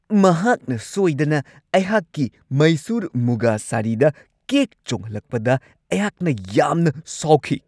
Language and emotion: Manipuri, angry